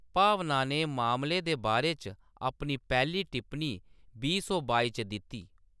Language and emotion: Dogri, neutral